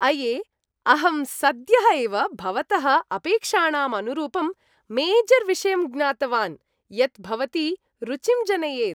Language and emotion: Sanskrit, happy